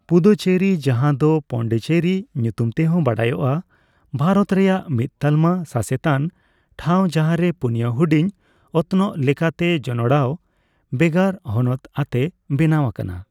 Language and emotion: Santali, neutral